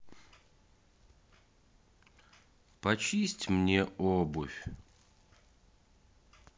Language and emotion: Russian, sad